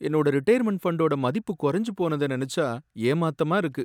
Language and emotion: Tamil, sad